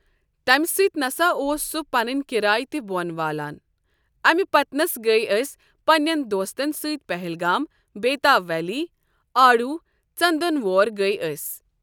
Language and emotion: Kashmiri, neutral